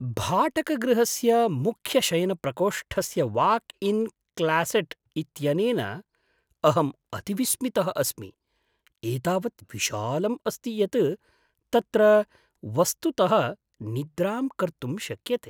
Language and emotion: Sanskrit, surprised